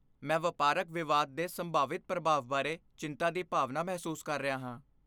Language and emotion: Punjabi, fearful